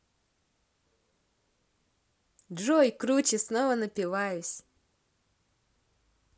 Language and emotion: Russian, positive